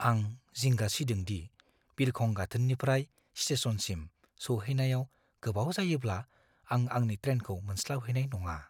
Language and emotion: Bodo, fearful